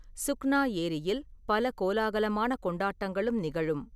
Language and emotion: Tamil, neutral